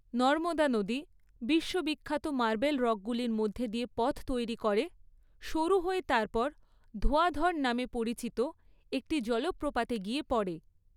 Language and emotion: Bengali, neutral